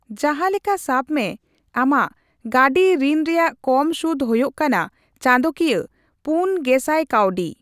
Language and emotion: Santali, neutral